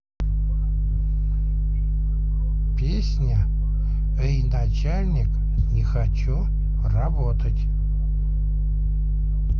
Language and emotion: Russian, neutral